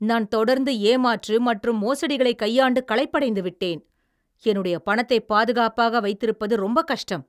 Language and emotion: Tamil, angry